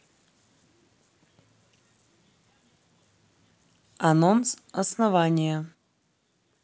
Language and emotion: Russian, neutral